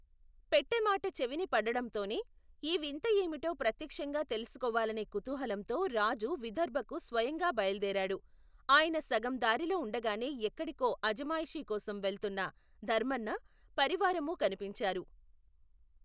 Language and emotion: Telugu, neutral